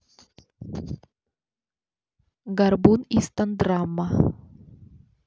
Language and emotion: Russian, neutral